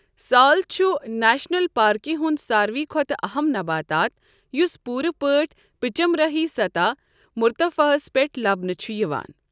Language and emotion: Kashmiri, neutral